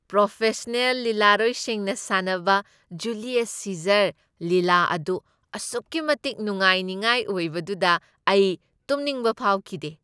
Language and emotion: Manipuri, happy